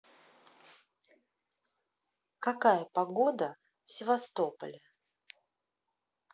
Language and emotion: Russian, neutral